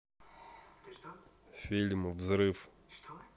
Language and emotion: Russian, neutral